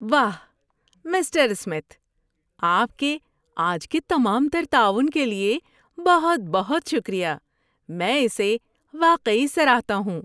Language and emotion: Urdu, happy